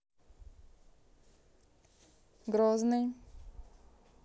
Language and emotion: Russian, neutral